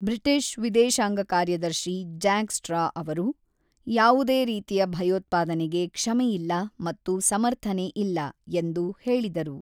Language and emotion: Kannada, neutral